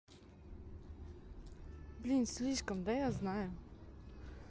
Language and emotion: Russian, neutral